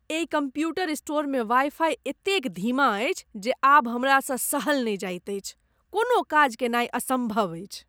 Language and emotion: Maithili, disgusted